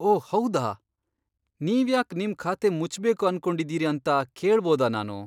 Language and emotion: Kannada, surprised